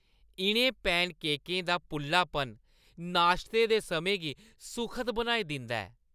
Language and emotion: Dogri, happy